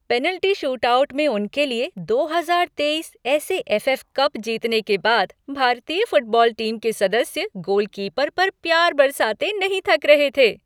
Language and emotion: Hindi, happy